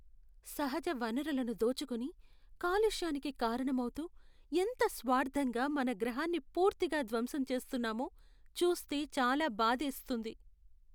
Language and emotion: Telugu, sad